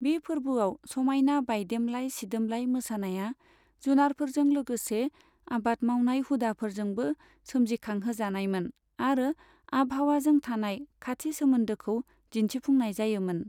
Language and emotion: Bodo, neutral